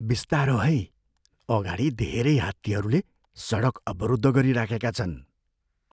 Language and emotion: Nepali, fearful